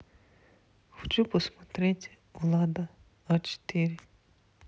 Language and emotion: Russian, neutral